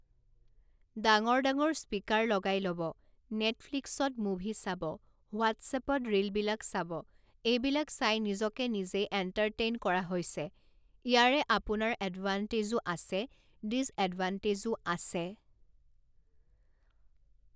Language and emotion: Assamese, neutral